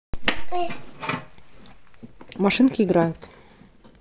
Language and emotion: Russian, neutral